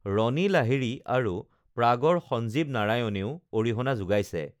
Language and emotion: Assamese, neutral